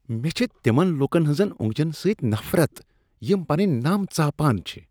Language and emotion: Kashmiri, disgusted